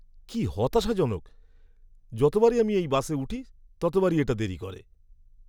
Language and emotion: Bengali, angry